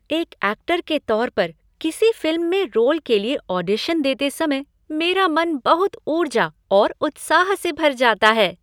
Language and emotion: Hindi, happy